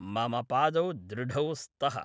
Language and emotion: Sanskrit, neutral